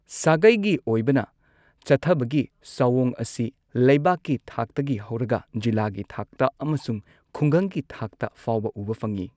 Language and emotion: Manipuri, neutral